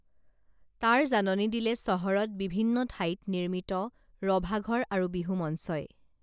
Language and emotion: Assamese, neutral